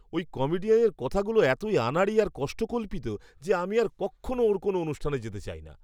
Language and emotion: Bengali, disgusted